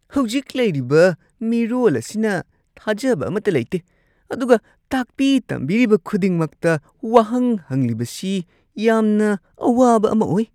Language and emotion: Manipuri, disgusted